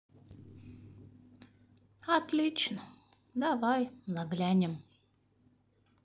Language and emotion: Russian, sad